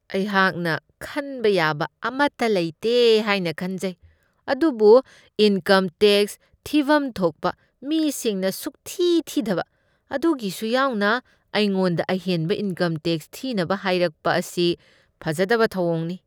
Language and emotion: Manipuri, disgusted